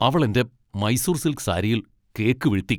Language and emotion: Malayalam, angry